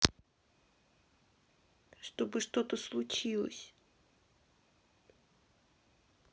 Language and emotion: Russian, sad